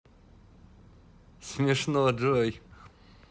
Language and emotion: Russian, positive